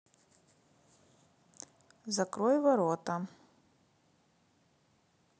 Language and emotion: Russian, neutral